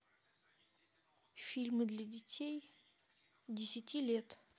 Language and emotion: Russian, neutral